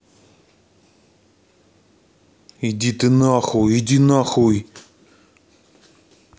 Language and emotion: Russian, angry